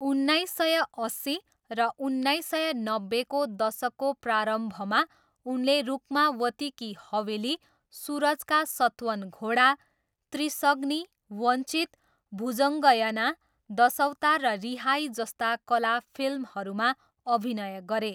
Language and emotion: Nepali, neutral